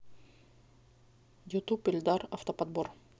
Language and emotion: Russian, neutral